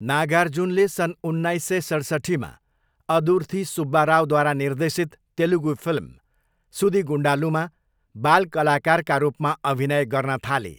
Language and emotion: Nepali, neutral